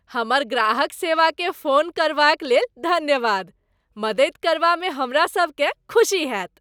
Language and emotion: Maithili, happy